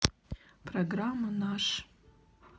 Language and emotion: Russian, neutral